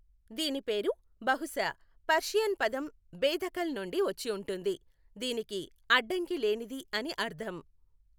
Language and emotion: Telugu, neutral